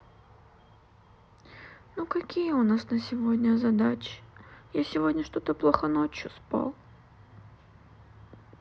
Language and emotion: Russian, sad